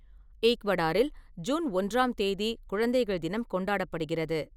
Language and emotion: Tamil, neutral